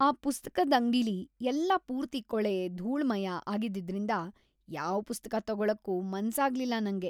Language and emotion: Kannada, disgusted